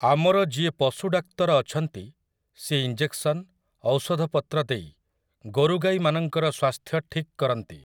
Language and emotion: Odia, neutral